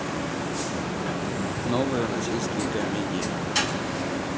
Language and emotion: Russian, neutral